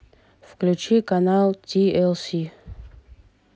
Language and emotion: Russian, neutral